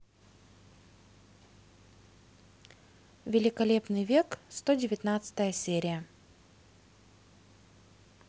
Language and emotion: Russian, neutral